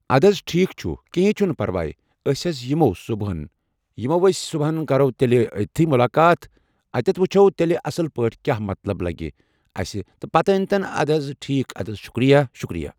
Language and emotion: Kashmiri, neutral